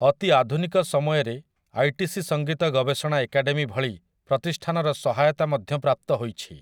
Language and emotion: Odia, neutral